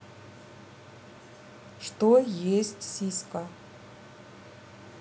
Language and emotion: Russian, neutral